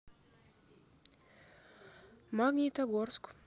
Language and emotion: Russian, neutral